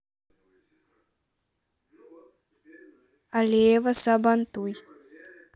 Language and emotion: Russian, neutral